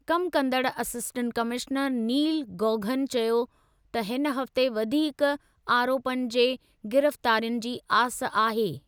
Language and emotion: Sindhi, neutral